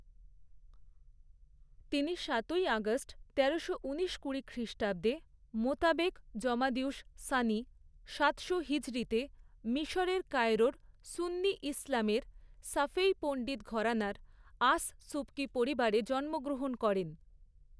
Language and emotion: Bengali, neutral